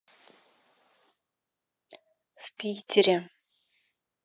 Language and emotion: Russian, neutral